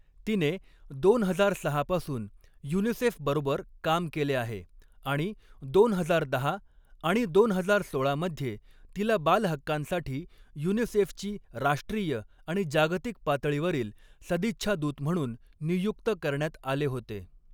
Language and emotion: Marathi, neutral